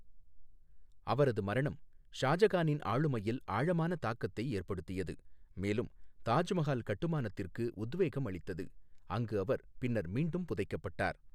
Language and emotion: Tamil, neutral